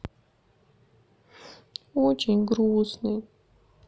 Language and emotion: Russian, sad